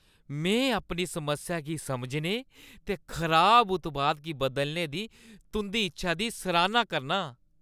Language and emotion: Dogri, happy